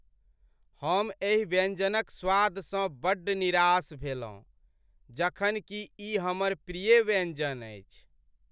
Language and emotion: Maithili, sad